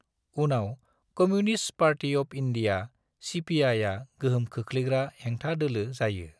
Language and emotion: Bodo, neutral